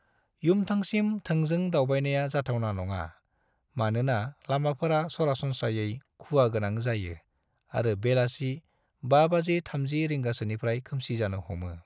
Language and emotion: Bodo, neutral